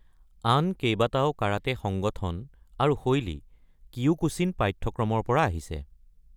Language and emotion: Assamese, neutral